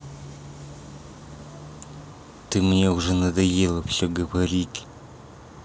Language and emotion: Russian, angry